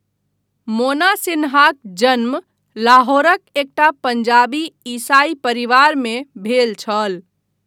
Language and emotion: Maithili, neutral